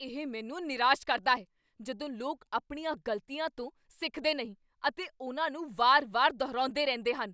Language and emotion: Punjabi, angry